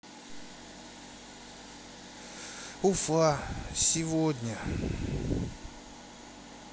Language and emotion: Russian, sad